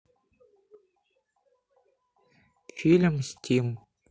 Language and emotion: Russian, neutral